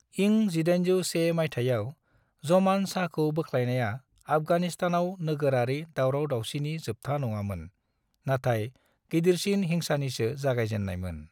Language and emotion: Bodo, neutral